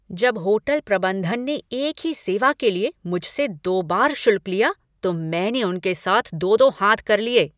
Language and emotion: Hindi, angry